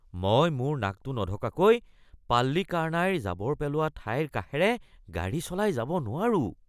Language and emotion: Assamese, disgusted